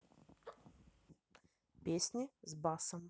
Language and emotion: Russian, neutral